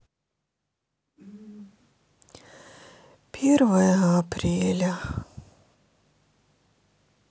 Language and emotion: Russian, sad